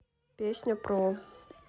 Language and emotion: Russian, neutral